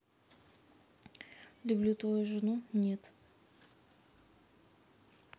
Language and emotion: Russian, neutral